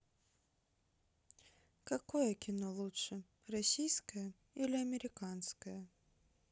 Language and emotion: Russian, sad